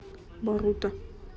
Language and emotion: Russian, neutral